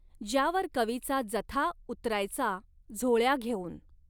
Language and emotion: Marathi, neutral